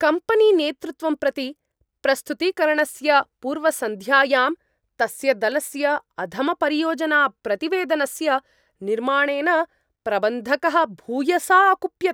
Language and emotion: Sanskrit, angry